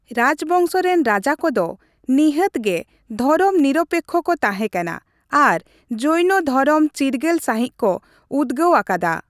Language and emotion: Santali, neutral